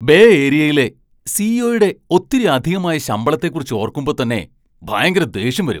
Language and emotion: Malayalam, angry